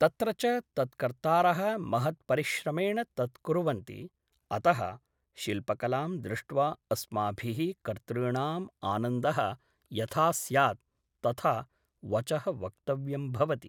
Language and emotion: Sanskrit, neutral